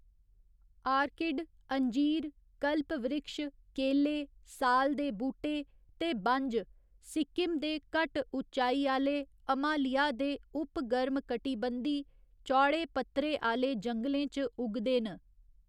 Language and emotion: Dogri, neutral